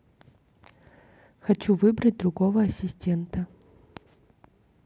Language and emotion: Russian, neutral